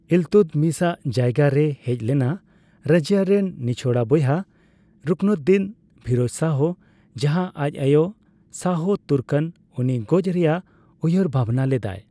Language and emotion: Santali, neutral